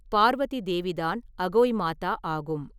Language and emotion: Tamil, neutral